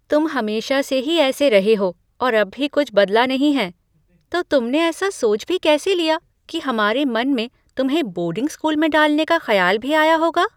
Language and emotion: Hindi, surprised